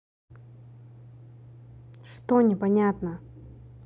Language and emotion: Russian, angry